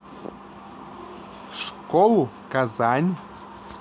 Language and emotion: Russian, neutral